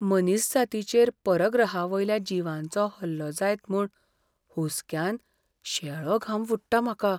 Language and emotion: Goan Konkani, fearful